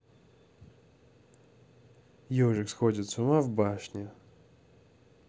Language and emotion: Russian, neutral